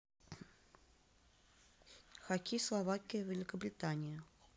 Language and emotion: Russian, neutral